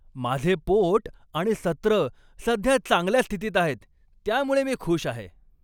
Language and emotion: Marathi, happy